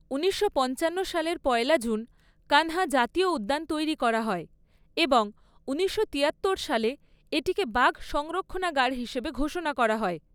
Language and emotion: Bengali, neutral